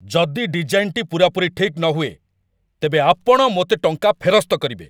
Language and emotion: Odia, angry